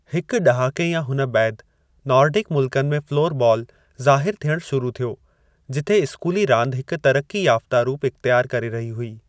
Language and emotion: Sindhi, neutral